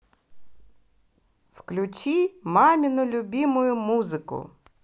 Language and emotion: Russian, positive